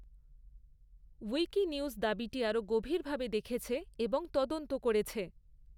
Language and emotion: Bengali, neutral